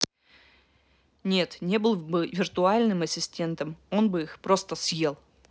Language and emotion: Russian, angry